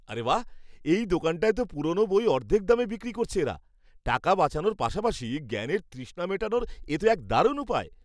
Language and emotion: Bengali, happy